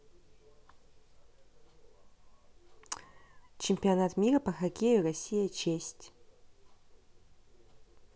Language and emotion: Russian, neutral